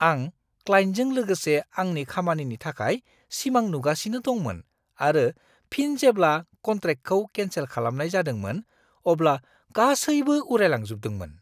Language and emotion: Bodo, surprised